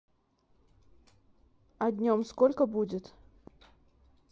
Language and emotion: Russian, neutral